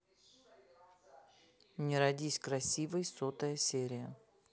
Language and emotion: Russian, neutral